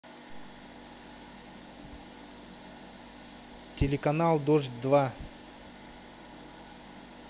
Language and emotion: Russian, neutral